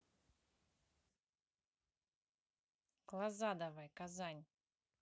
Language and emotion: Russian, neutral